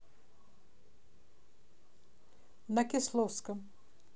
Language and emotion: Russian, neutral